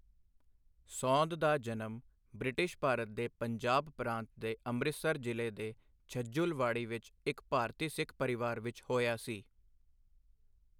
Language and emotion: Punjabi, neutral